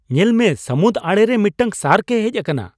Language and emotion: Santali, surprised